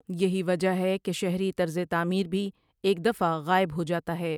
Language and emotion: Urdu, neutral